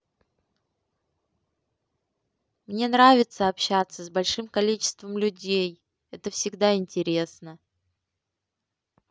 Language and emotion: Russian, positive